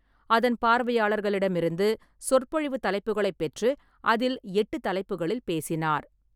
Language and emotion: Tamil, neutral